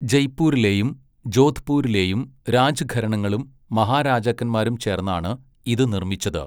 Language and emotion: Malayalam, neutral